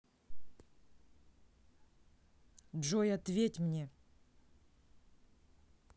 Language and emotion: Russian, angry